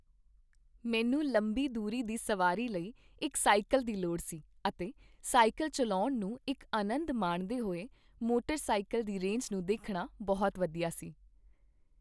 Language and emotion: Punjabi, happy